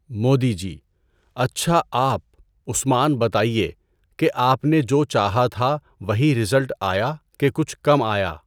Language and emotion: Urdu, neutral